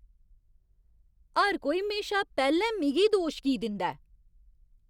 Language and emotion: Dogri, angry